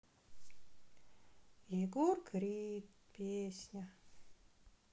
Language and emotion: Russian, sad